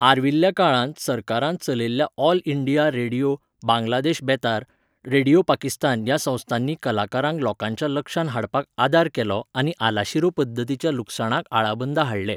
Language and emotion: Goan Konkani, neutral